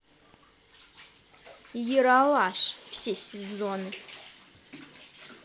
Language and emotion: Russian, positive